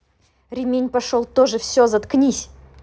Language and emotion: Russian, angry